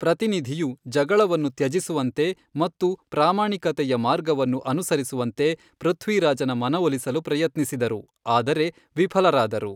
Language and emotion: Kannada, neutral